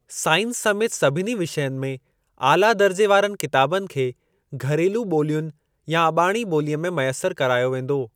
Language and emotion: Sindhi, neutral